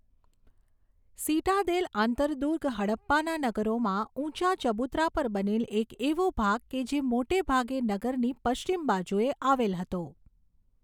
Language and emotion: Gujarati, neutral